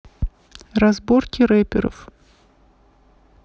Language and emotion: Russian, neutral